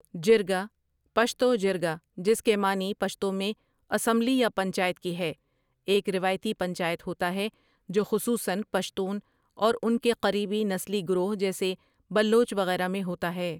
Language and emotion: Urdu, neutral